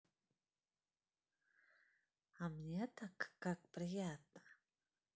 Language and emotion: Russian, positive